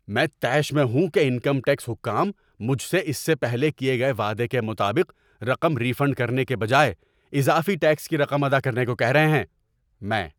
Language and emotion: Urdu, angry